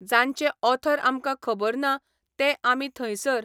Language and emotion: Goan Konkani, neutral